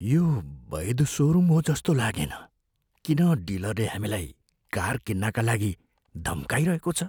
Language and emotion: Nepali, fearful